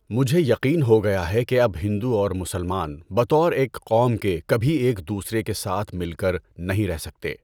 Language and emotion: Urdu, neutral